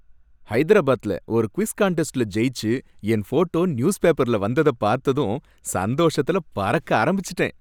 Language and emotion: Tamil, happy